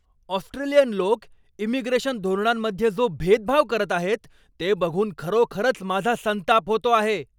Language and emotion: Marathi, angry